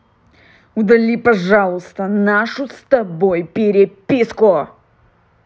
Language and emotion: Russian, angry